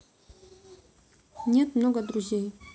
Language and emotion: Russian, neutral